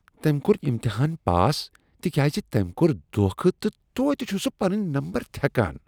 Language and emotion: Kashmiri, disgusted